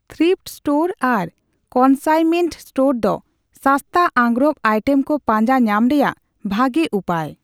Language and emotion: Santali, neutral